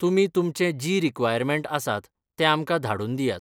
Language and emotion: Goan Konkani, neutral